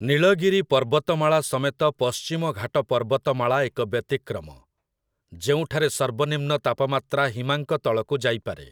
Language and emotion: Odia, neutral